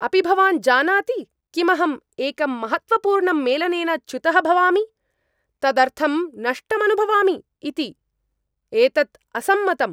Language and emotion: Sanskrit, angry